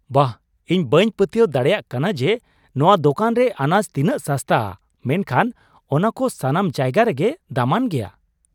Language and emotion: Santali, surprised